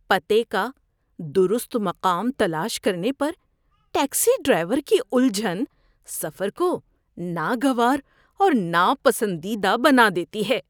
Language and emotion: Urdu, disgusted